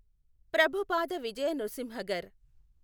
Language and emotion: Telugu, neutral